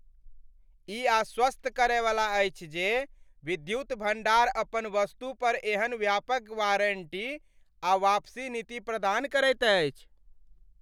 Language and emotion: Maithili, happy